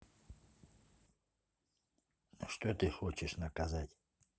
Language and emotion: Russian, neutral